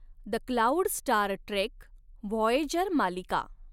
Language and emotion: Marathi, neutral